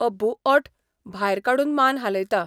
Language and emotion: Goan Konkani, neutral